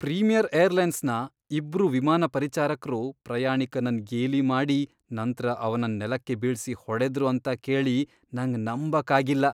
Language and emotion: Kannada, disgusted